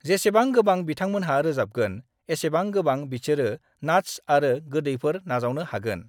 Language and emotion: Bodo, neutral